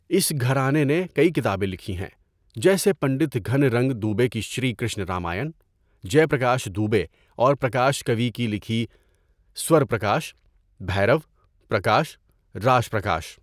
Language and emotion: Urdu, neutral